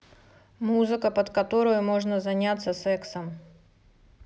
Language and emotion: Russian, neutral